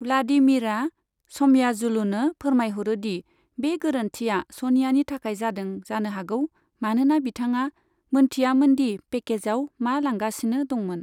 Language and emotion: Bodo, neutral